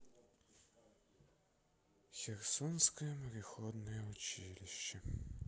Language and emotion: Russian, sad